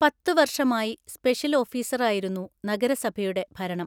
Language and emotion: Malayalam, neutral